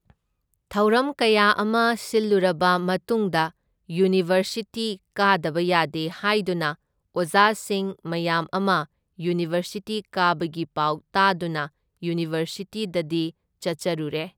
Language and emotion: Manipuri, neutral